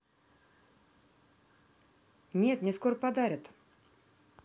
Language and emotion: Russian, positive